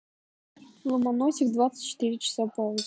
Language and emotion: Russian, neutral